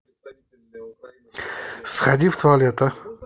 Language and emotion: Russian, angry